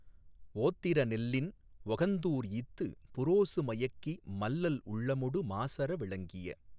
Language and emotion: Tamil, neutral